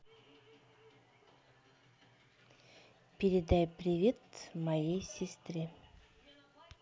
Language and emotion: Russian, neutral